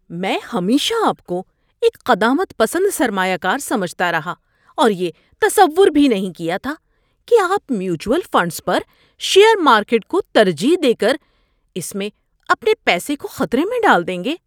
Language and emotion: Urdu, surprised